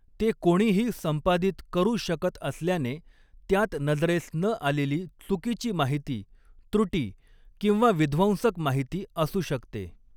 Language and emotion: Marathi, neutral